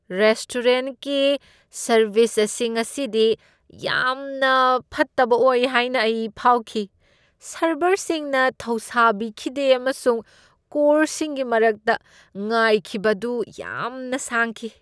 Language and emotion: Manipuri, disgusted